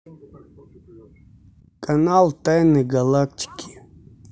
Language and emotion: Russian, neutral